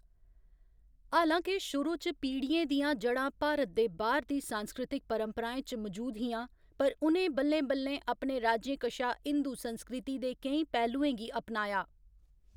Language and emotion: Dogri, neutral